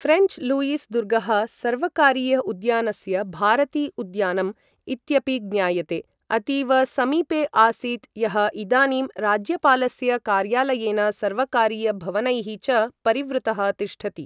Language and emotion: Sanskrit, neutral